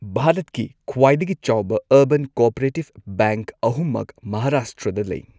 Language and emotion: Manipuri, neutral